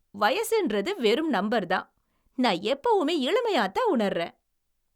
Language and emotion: Tamil, happy